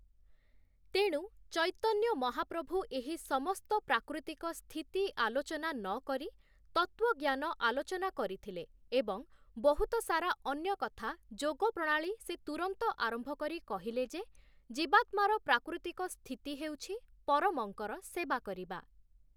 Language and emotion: Odia, neutral